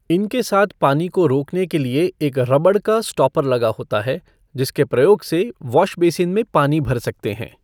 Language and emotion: Hindi, neutral